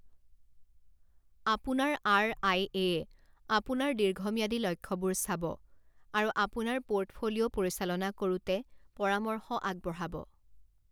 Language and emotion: Assamese, neutral